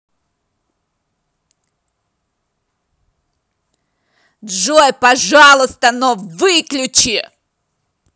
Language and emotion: Russian, angry